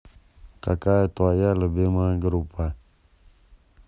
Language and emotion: Russian, neutral